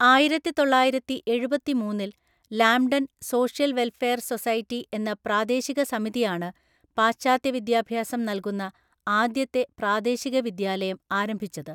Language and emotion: Malayalam, neutral